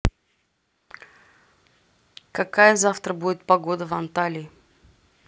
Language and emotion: Russian, neutral